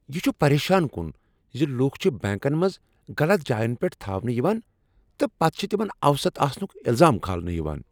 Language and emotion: Kashmiri, angry